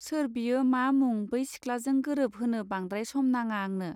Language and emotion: Bodo, neutral